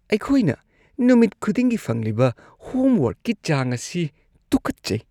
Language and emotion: Manipuri, disgusted